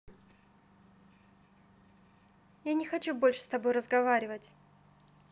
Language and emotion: Russian, neutral